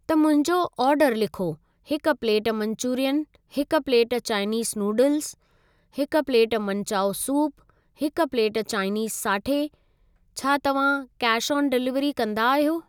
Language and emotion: Sindhi, neutral